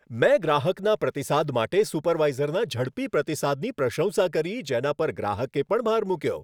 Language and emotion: Gujarati, happy